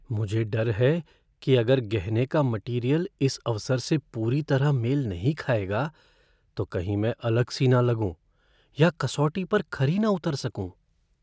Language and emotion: Hindi, fearful